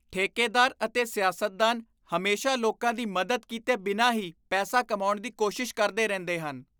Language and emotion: Punjabi, disgusted